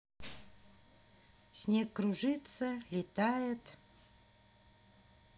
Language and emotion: Russian, neutral